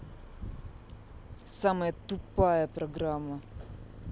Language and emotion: Russian, angry